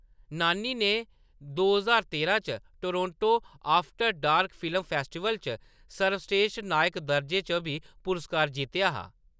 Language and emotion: Dogri, neutral